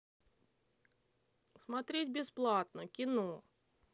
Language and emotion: Russian, neutral